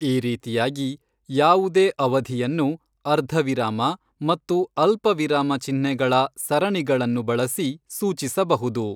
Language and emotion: Kannada, neutral